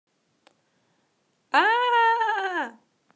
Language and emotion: Russian, positive